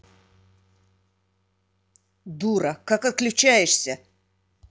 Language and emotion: Russian, angry